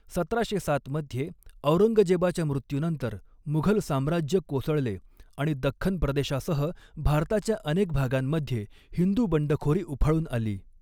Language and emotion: Marathi, neutral